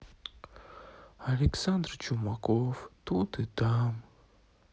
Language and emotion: Russian, sad